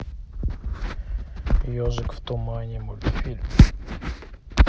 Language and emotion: Russian, neutral